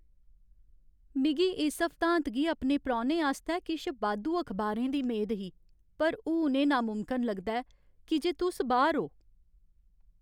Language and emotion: Dogri, sad